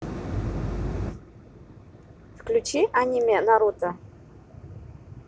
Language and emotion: Russian, neutral